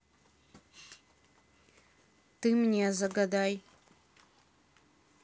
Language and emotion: Russian, neutral